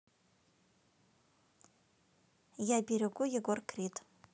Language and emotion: Russian, neutral